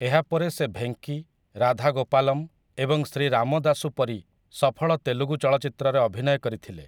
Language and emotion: Odia, neutral